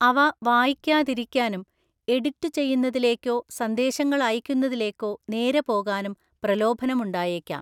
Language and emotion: Malayalam, neutral